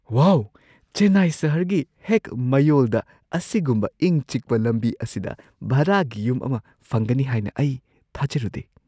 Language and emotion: Manipuri, surprised